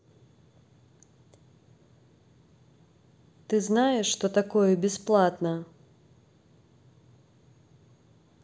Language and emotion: Russian, neutral